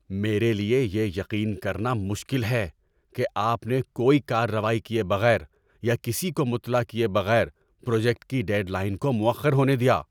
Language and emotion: Urdu, angry